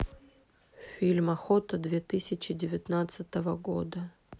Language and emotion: Russian, neutral